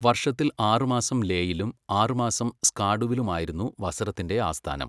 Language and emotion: Malayalam, neutral